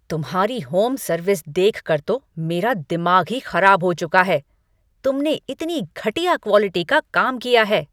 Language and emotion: Hindi, angry